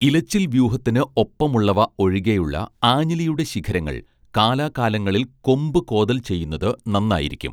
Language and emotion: Malayalam, neutral